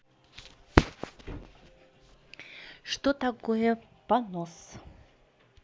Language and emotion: Russian, neutral